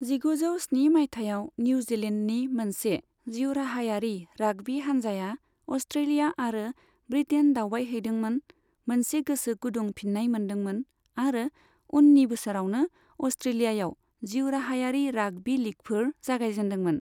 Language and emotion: Bodo, neutral